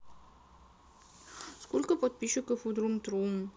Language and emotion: Russian, sad